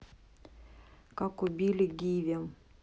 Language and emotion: Russian, neutral